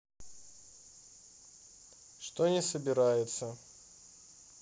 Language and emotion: Russian, neutral